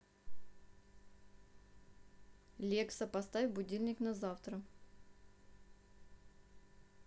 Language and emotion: Russian, neutral